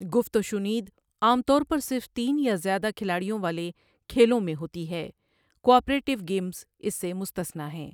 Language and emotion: Urdu, neutral